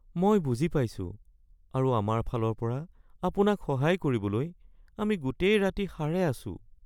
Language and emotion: Assamese, sad